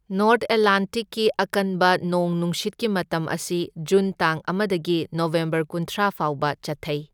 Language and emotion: Manipuri, neutral